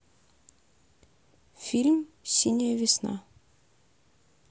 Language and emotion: Russian, neutral